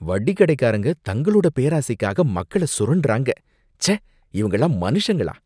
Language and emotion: Tamil, disgusted